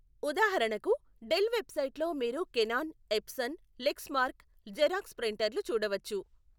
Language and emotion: Telugu, neutral